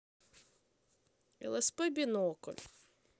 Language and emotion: Russian, sad